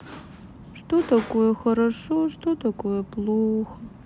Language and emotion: Russian, sad